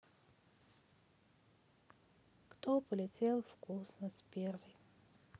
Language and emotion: Russian, sad